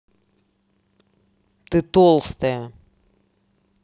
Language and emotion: Russian, angry